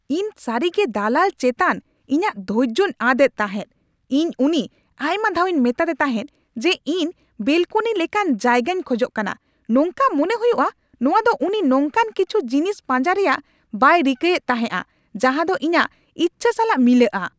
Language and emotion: Santali, angry